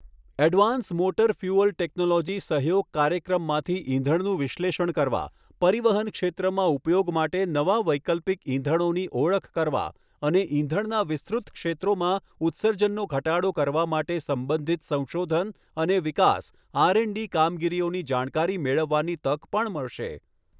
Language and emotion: Gujarati, neutral